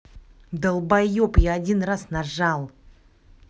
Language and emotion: Russian, angry